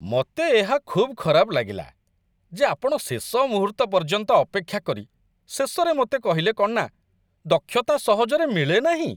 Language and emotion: Odia, disgusted